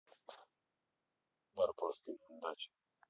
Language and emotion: Russian, neutral